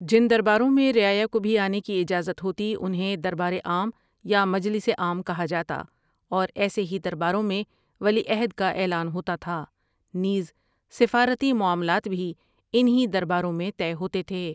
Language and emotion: Urdu, neutral